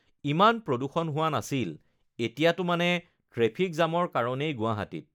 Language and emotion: Assamese, neutral